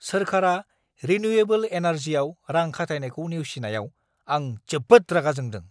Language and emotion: Bodo, angry